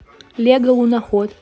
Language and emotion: Russian, neutral